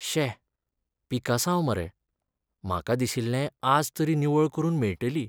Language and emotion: Goan Konkani, sad